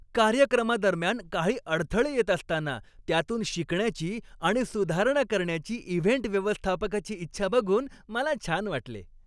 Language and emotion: Marathi, happy